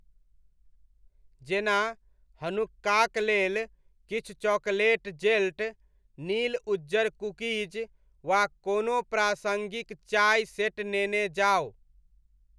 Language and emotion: Maithili, neutral